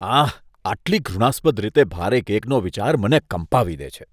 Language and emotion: Gujarati, disgusted